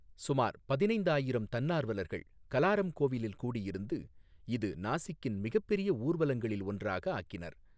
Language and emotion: Tamil, neutral